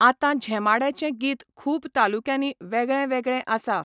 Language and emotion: Goan Konkani, neutral